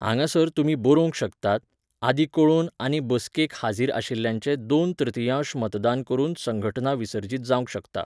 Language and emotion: Goan Konkani, neutral